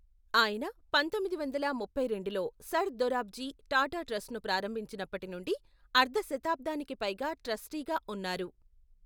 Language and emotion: Telugu, neutral